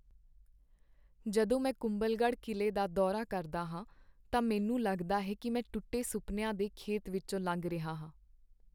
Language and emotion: Punjabi, sad